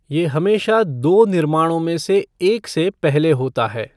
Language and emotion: Hindi, neutral